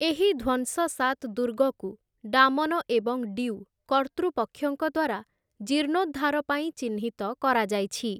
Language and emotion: Odia, neutral